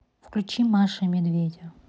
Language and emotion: Russian, neutral